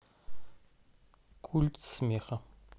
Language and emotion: Russian, neutral